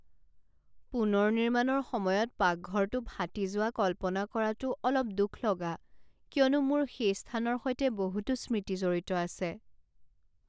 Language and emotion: Assamese, sad